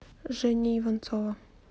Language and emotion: Russian, neutral